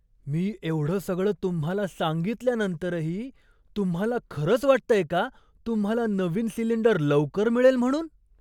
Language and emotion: Marathi, surprised